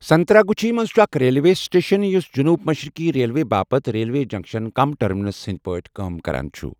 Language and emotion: Kashmiri, neutral